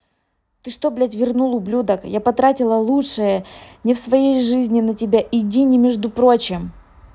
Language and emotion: Russian, angry